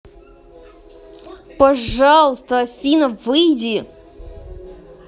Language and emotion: Russian, angry